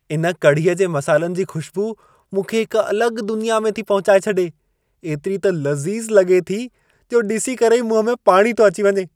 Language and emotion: Sindhi, happy